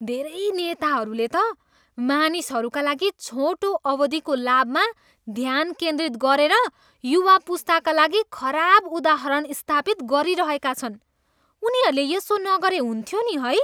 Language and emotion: Nepali, disgusted